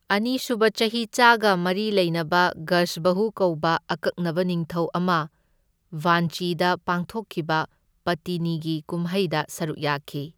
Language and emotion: Manipuri, neutral